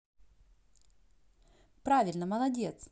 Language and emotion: Russian, positive